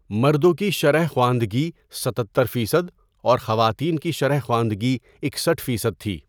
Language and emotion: Urdu, neutral